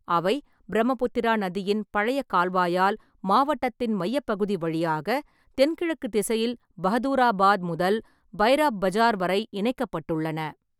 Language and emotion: Tamil, neutral